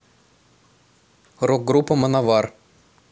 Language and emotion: Russian, neutral